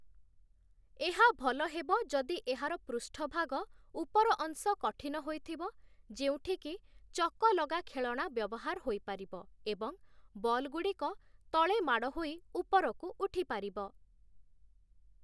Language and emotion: Odia, neutral